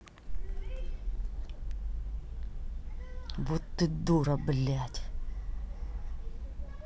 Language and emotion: Russian, angry